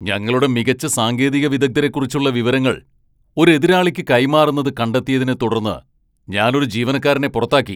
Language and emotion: Malayalam, angry